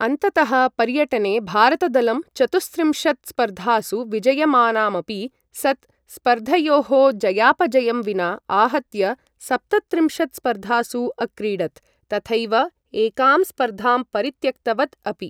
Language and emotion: Sanskrit, neutral